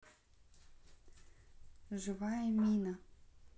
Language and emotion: Russian, neutral